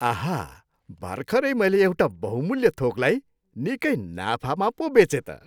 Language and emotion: Nepali, happy